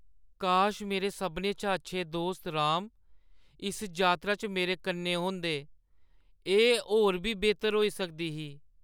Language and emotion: Dogri, sad